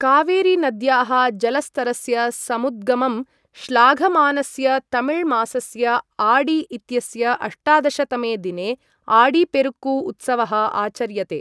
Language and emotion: Sanskrit, neutral